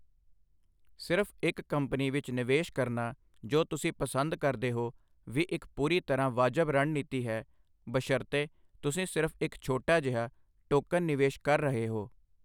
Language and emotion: Punjabi, neutral